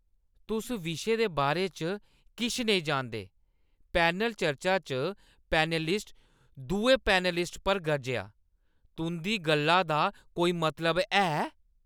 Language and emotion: Dogri, angry